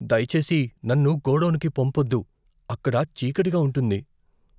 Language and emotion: Telugu, fearful